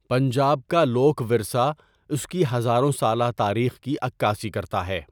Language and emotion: Urdu, neutral